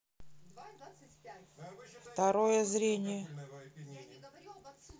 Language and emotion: Russian, neutral